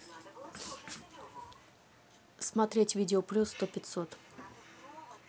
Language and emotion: Russian, neutral